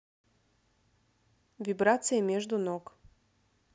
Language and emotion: Russian, neutral